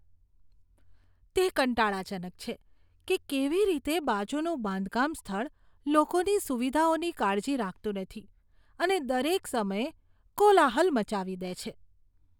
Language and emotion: Gujarati, disgusted